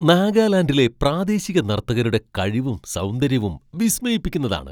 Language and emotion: Malayalam, surprised